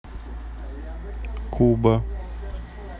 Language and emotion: Russian, neutral